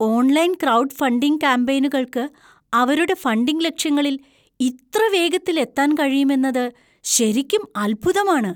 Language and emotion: Malayalam, surprised